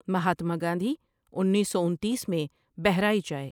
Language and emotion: Urdu, neutral